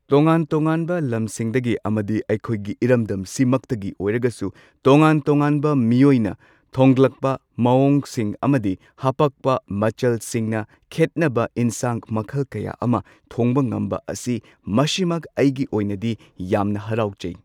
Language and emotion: Manipuri, neutral